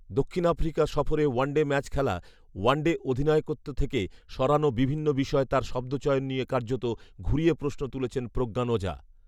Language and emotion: Bengali, neutral